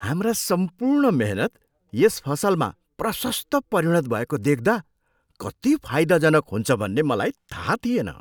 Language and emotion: Nepali, surprised